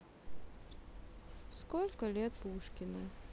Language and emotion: Russian, sad